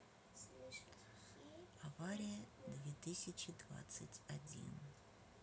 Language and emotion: Russian, neutral